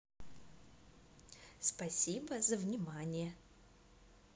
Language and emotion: Russian, positive